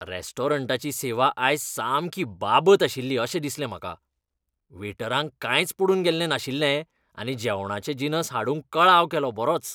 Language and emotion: Goan Konkani, disgusted